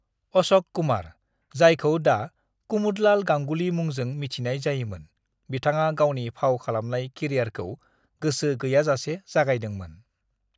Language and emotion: Bodo, neutral